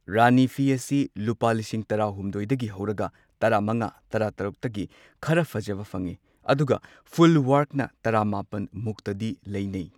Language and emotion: Manipuri, neutral